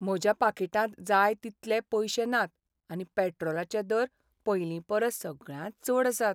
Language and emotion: Goan Konkani, sad